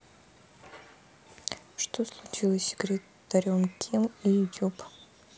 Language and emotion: Russian, sad